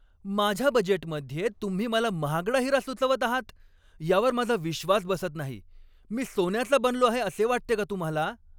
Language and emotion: Marathi, angry